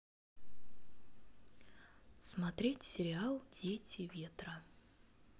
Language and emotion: Russian, neutral